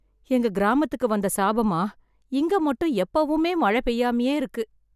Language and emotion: Tamil, sad